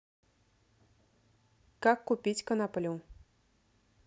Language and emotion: Russian, neutral